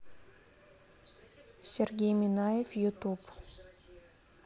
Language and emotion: Russian, neutral